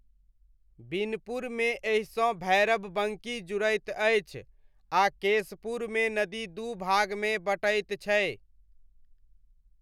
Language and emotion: Maithili, neutral